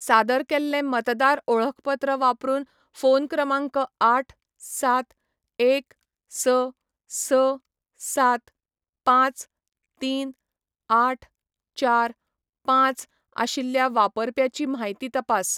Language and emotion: Goan Konkani, neutral